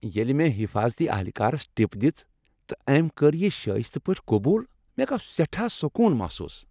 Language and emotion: Kashmiri, happy